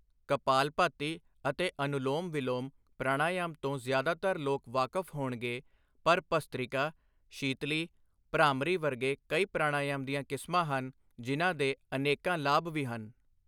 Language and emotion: Punjabi, neutral